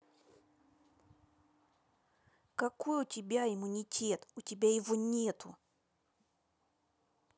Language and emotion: Russian, angry